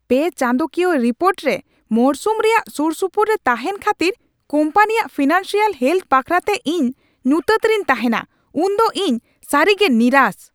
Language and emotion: Santali, angry